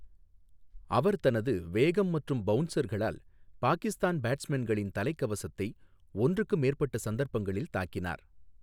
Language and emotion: Tamil, neutral